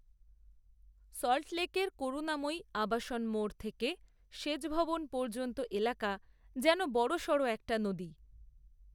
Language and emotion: Bengali, neutral